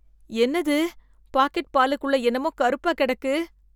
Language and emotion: Tamil, disgusted